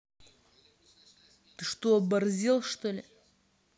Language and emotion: Russian, angry